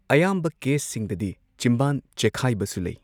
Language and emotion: Manipuri, neutral